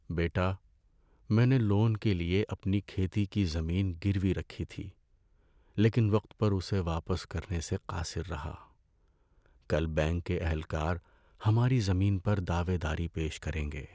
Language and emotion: Urdu, sad